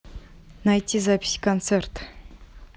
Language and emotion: Russian, neutral